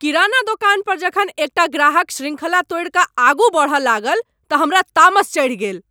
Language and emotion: Maithili, angry